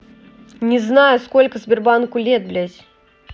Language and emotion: Russian, angry